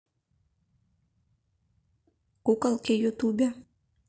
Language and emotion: Russian, neutral